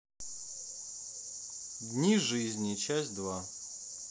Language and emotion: Russian, neutral